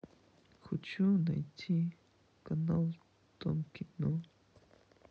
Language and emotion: Russian, sad